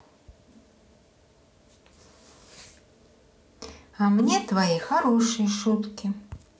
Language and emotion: Russian, neutral